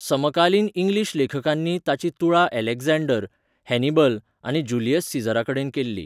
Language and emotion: Goan Konkani, neutral